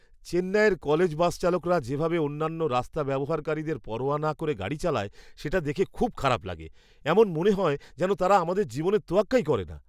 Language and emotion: Bengali, disgusted